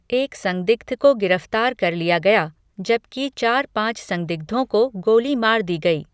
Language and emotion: Hindi, neutral